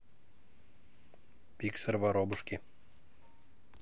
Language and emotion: Russian, neutral